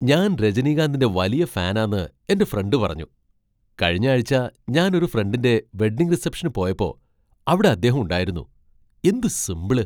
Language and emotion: Malayalam, surprised